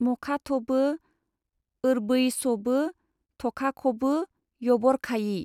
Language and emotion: Bodo, neutral